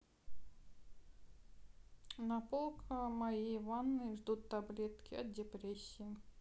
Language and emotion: Russian, sad